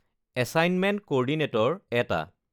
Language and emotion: Assamese, neutral